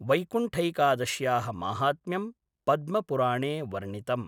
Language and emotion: Sanskrit, neutral